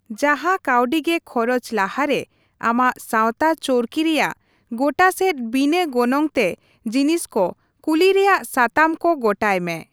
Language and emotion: Santali, neutral